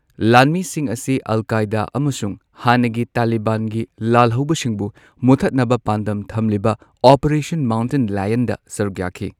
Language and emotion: Manipuri, neutral